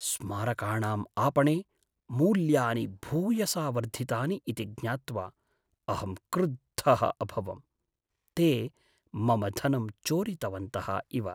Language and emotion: Sanskrit, sad